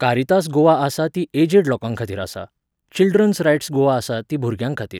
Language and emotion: Goan Konkani, neutral